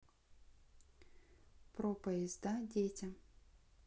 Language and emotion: Russian, neutral